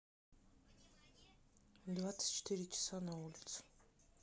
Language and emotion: Russian, neutral